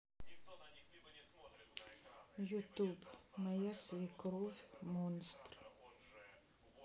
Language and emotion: Russian, sad